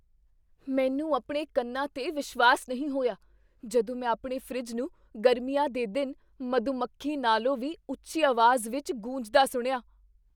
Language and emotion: Punjabi, surprised